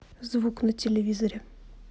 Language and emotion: Russian, neutral